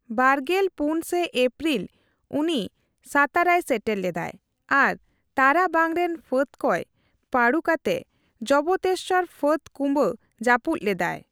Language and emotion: Santali, neutral